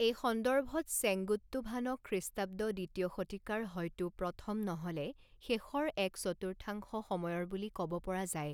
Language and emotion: Assamese, neutral